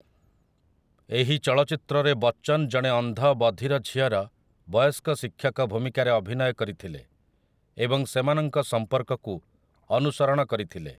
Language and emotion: Odia, neutral